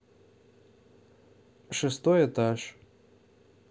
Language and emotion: Russian, neutral